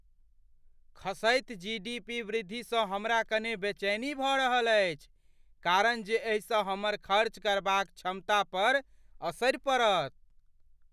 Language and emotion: Maithili, fearful